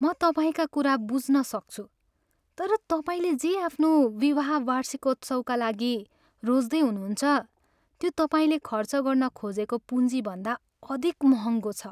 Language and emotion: Nepali, sad